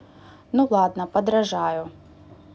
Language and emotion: Russian, neutral